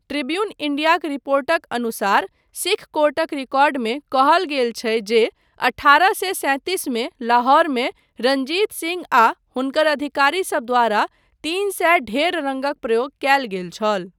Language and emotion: Maithili, neutral